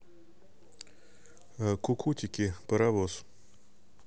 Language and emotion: Russian, neutral